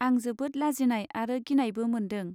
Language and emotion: Bodo, neutral